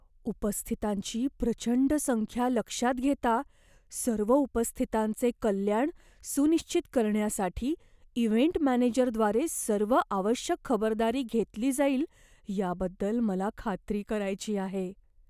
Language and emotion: Marathi, fearful